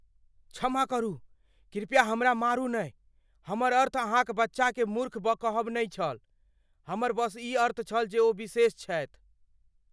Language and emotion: Maithili, fearful